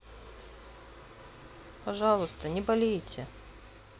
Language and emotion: Russian, sad